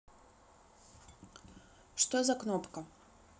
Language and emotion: Russian, neutral